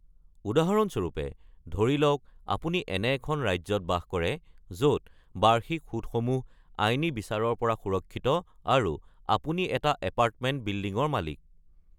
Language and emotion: Assamese, neutral